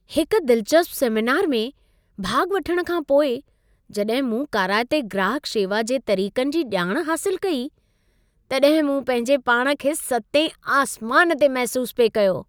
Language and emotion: Sindhi, happy